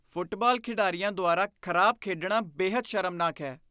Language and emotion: Punjabi, disgusted